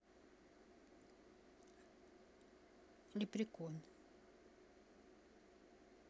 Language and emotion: Russian, neutral